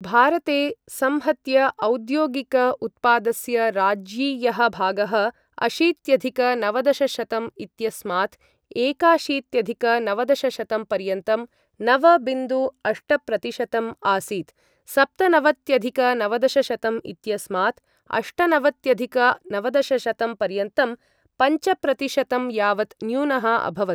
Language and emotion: Sanskrit, neutral